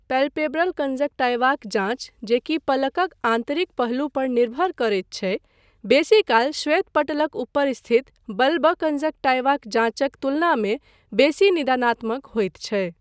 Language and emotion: Maithili, neutral